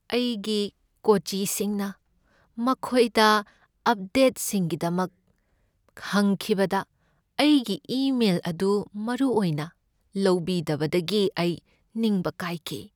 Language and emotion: Manipuri, sad